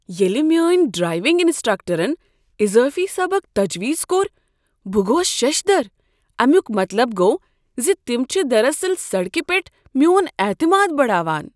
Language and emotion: Kashmiri, surprised